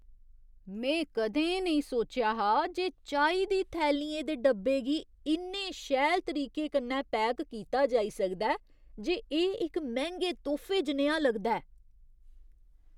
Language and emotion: Dogri, surprised